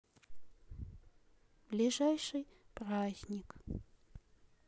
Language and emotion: Russian, sad